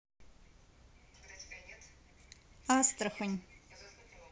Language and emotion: Russian, neutral